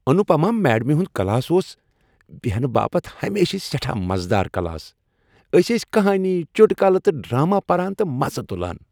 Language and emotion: Kashmiri, happy